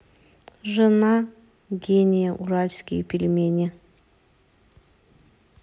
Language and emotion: Russian, neutral